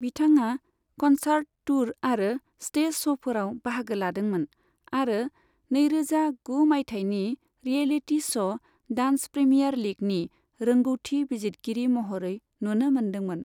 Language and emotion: Bodo, neutral